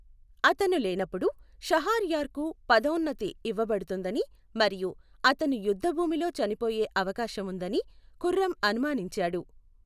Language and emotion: Telugu, neutral